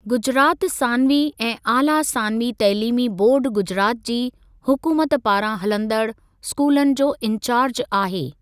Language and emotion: Sindhi, neutral